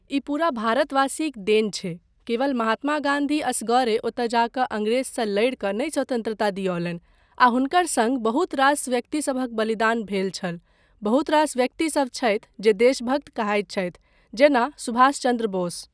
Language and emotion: Maithili, neutral